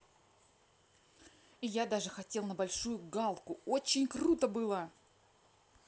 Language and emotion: Russian, neutral